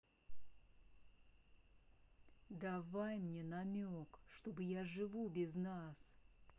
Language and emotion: Russian, angry